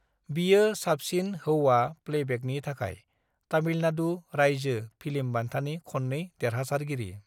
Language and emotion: Bodo, neutral